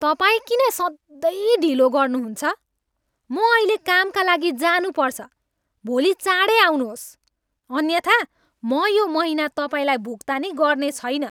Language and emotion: Nepali, angry